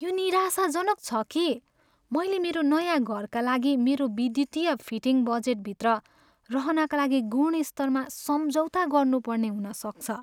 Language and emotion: Nepali, sad